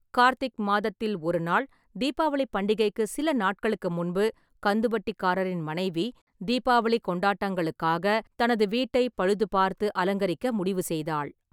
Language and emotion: Tamil, neutral